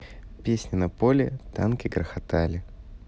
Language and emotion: Russian, neutral